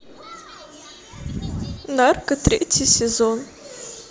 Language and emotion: Russian, sad